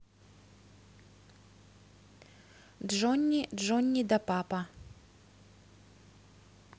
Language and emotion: Russian, neutral